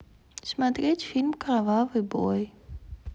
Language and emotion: Russian, neutral